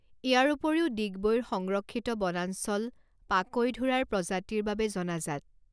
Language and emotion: Assamese, neutral